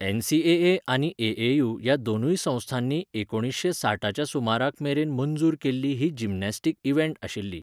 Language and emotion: Goan Konkani, neutral